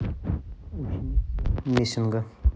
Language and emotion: Russian, neutral